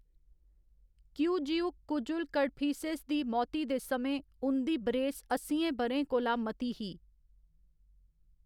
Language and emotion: Dogri, neutral